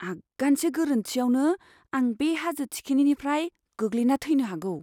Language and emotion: Bodo, fearful